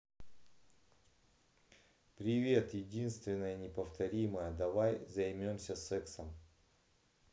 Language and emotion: Russian, neutral